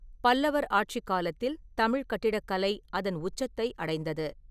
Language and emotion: Tamil, neutral